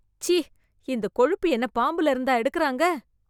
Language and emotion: Tamil, disgusted